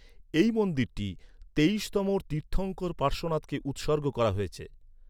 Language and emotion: Bengali, neutral